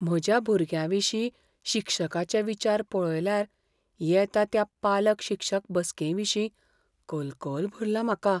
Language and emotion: Goan Konkani, fearful